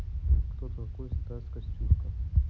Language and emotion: Russian, neutral